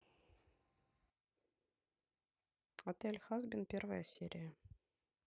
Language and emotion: Russian, neutral